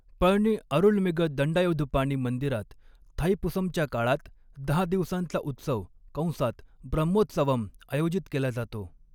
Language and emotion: Marathi, neutral